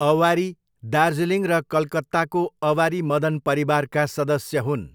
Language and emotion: Nepali, neutral